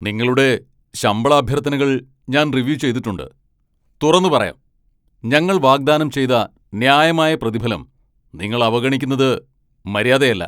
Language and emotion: Malayalam, angry